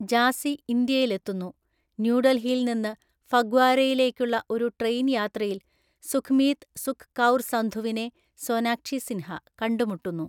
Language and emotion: Malayalam, neutral